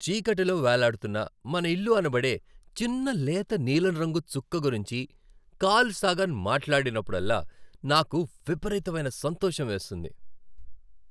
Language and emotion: Telugu, happy